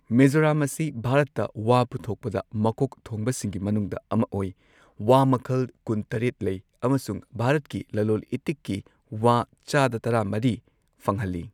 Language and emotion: Manipuri, neutral